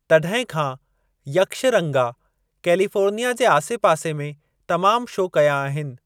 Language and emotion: Sindhi, neutral